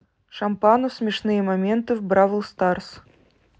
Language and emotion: Russian, neutral